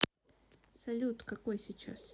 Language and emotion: Russian, neutral